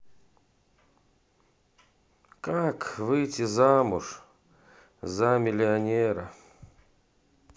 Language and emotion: Russian, sad